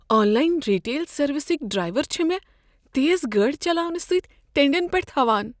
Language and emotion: Kashmiri, fearful